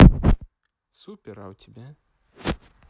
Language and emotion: Russian, neutral